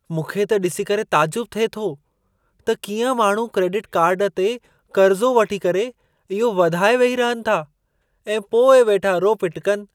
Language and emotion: Sindhi, surprised